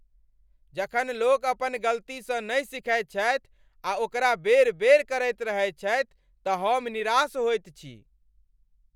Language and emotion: Maithili, angry